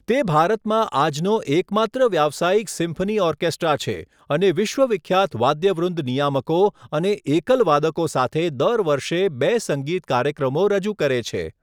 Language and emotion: Gujarati, neutral